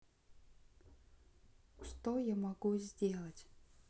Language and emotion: Russian, sad